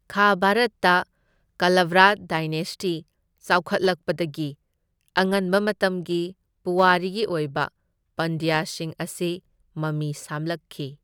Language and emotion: Manipuri, neutral